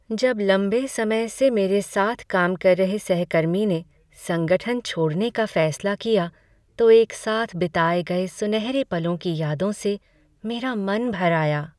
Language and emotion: Hindi, sad